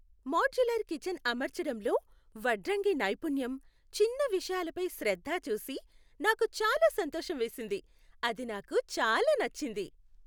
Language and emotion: Telugu, happy